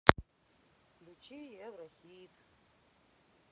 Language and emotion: Russian, sad